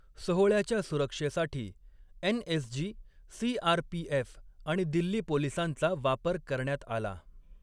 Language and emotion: Marathi, neutral